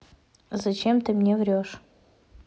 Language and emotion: Russian, angry